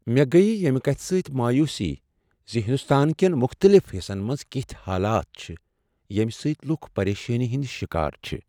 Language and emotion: Kashmiri, sad